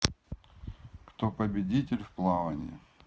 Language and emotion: Russian, neutral